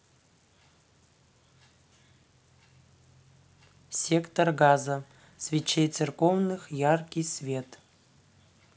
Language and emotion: Russian, neutral